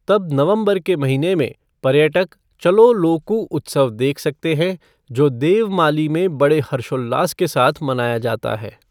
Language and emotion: Hindi, neutral